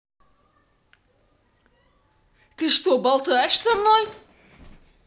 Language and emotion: Russian, angry